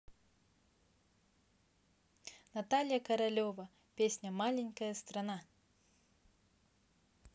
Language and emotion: Russian, positive